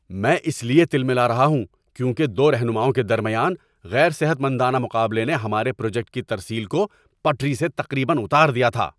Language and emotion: Urdu, angry